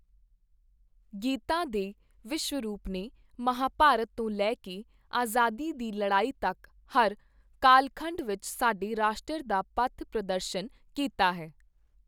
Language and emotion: Punjabi, neutral